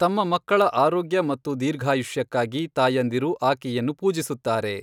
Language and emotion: Kannada, neutral